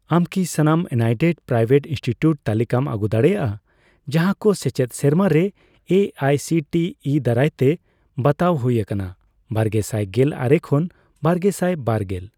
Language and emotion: Santali, neutral